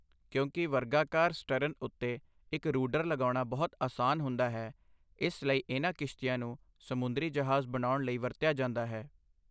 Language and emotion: Punjabi, neutral